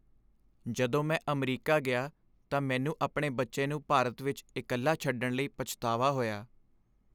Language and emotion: Punjabi, sad